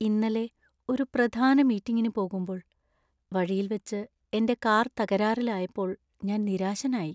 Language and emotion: Malayalam, sad